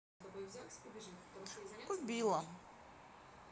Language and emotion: Russian, neutral